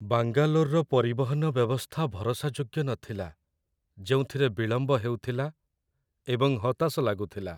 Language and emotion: Odia, sad